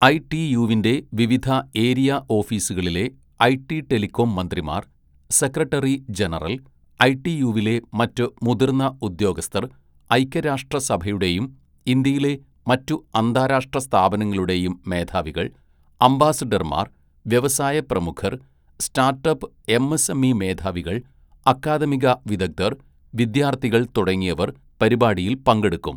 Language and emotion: Malayalam, neutral